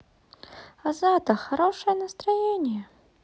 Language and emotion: Russian, positive